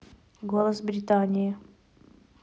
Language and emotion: Russian, neutral